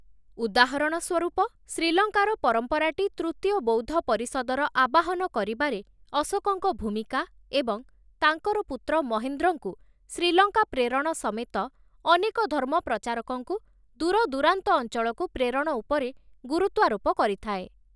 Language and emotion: Odia, neutral